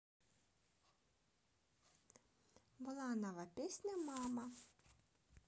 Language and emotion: Russian, neutral